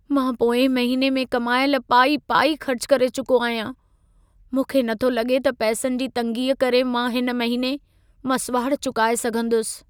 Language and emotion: Sindhi, sad